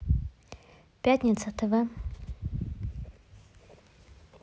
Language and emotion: Russian, neutral